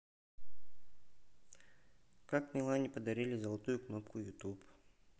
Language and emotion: Russian, neutral